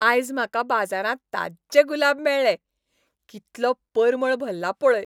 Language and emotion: Goan Konkani, happy